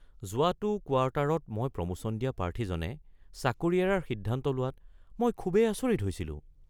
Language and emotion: Assamese, surprised